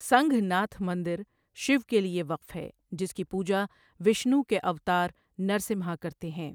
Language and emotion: Urdu, neutral